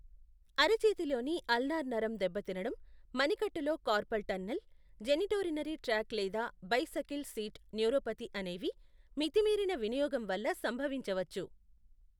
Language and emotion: Telugu, neutral